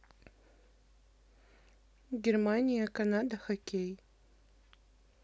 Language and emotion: Russian, neutral